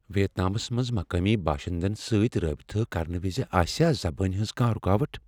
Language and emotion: Kashmiri, fearful